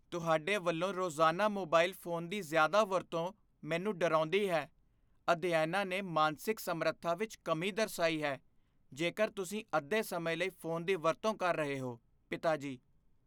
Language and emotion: Punjabi, fearful